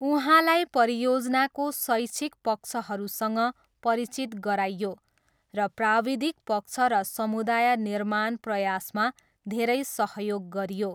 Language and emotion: Nepali, neutral